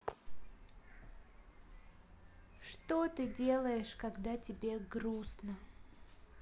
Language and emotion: Russian, sad